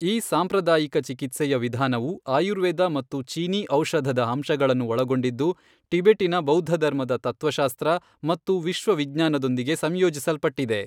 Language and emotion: Kannada, neutral